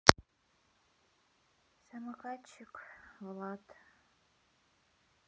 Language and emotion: Russian, sad